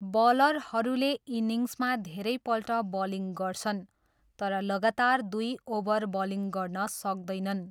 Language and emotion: Nepali, neutral